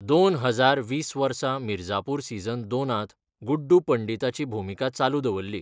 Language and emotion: Goan Konkani, neutral